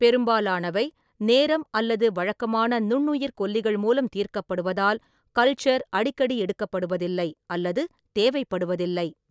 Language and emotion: Tamil, neutral